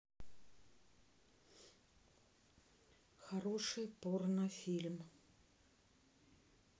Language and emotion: Russian, neutral